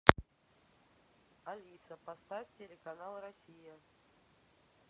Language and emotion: Russian, neutral